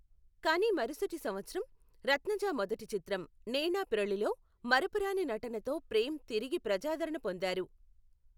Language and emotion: Telugu, neutral